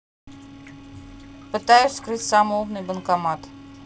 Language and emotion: Russian, neutral